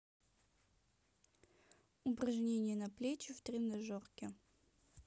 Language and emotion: Russian, neutral